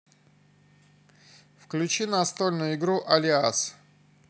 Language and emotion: Russian, neutral